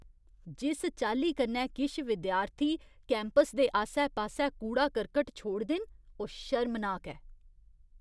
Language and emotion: Dogri, disgusted